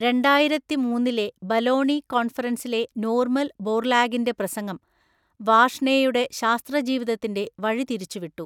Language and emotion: Malayalam, neutral